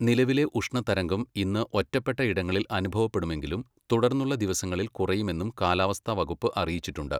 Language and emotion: Malayalam, neutral